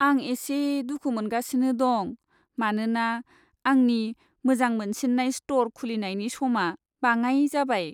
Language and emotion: Bodo, sad